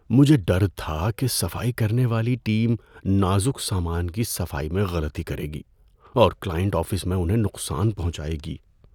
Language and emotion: Urdu, fearful